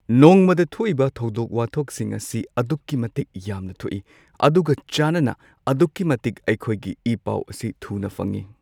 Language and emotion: Manipuri, neutral